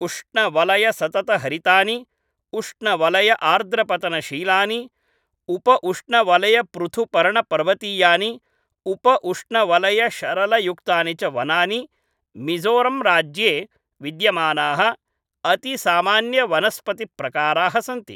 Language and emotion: Sanskrit, neutral